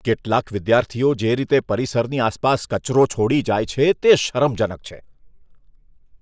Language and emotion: Gujarati, disgusted